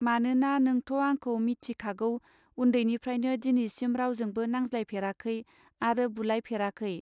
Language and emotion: Bodo, neutral